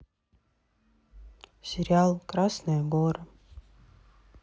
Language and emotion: Russian, sad